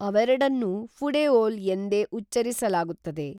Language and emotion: Kannada, neutral